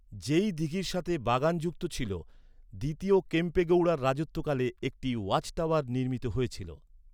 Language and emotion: Bengali, neutral